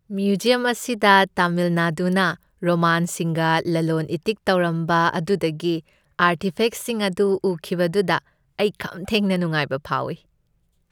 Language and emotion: Manipuri, happy